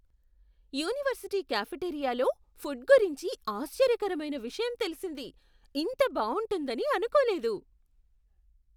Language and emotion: Telugu, surprised